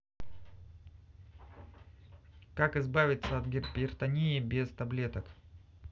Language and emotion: Russian, neutral